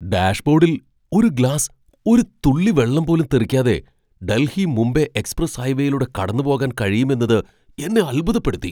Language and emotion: Malayalam, surprised